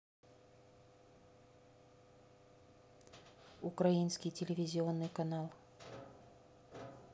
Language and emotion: Russian, neutral